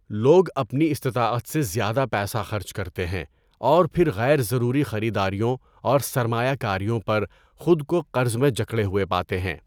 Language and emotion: Urdu, neutral